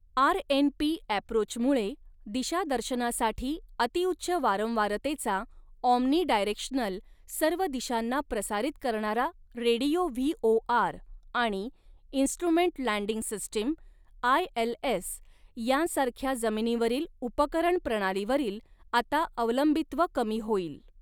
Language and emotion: Marathi, neutral